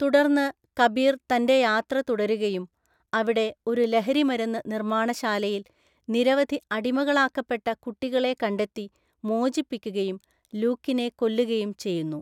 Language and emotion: Malayalam, neutral